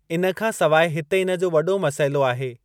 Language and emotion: Sindhi, neutral